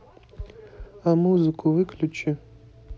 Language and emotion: Russian, neutral